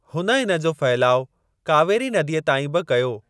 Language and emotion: Sindhi, neutral